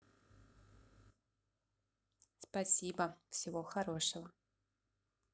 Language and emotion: Russian, positive